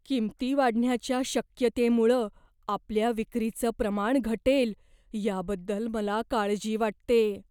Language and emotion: Marathi, fearful